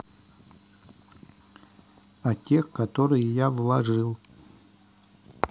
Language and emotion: Russian, neutral